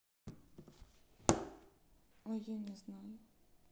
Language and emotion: Russian, neutral